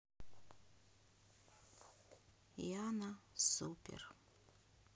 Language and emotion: Russian, sad